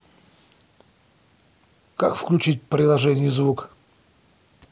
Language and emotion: Russian, neutral